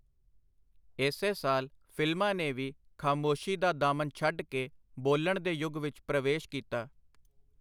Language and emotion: Punjabi, neutral